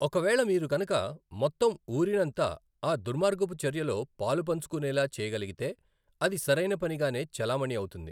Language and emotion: Telugu, neutral